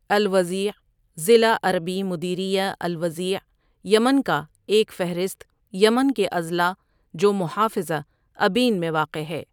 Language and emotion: Urdu, neutral